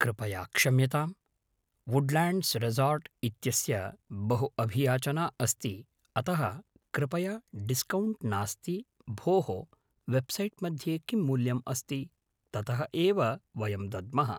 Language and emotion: Sanskrit, neutral